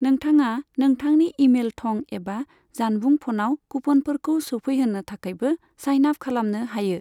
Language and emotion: Bodo, neutral